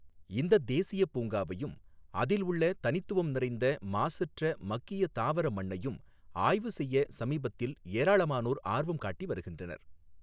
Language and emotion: Tamil, neutral